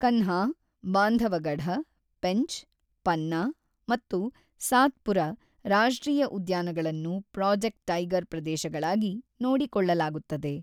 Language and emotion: Kannada, neutral